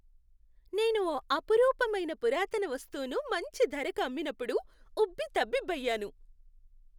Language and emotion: Telugu, happy